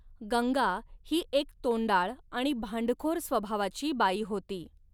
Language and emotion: Marathi, neutral